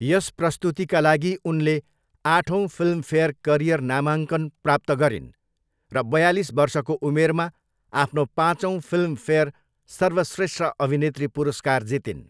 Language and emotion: Nepali, neutral